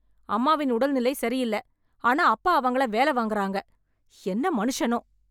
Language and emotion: Tamil, angry